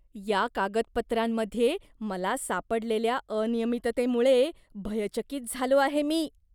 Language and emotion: Marathi, disgusted